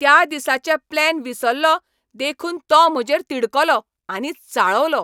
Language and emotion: Goan Konkani, angry